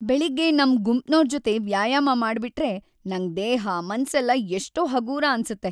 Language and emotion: Kannada, happy